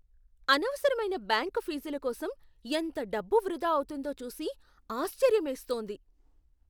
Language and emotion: Telugu, surprised